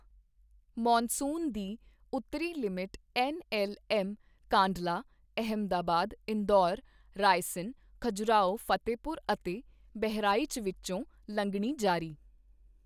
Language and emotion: Punjabi, neutral